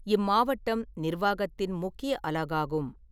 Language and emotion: Tamil, neutral